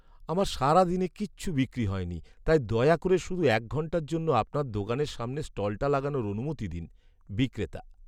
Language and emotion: Bengali, sad